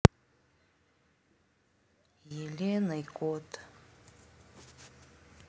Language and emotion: Russian, sad